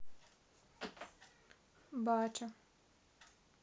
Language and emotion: Russian, neutral